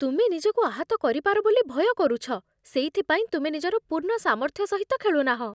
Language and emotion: Odia, fearful